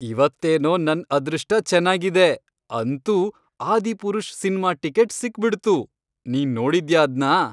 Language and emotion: Kannada, happy